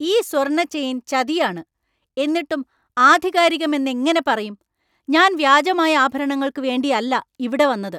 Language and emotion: Malayalam, angry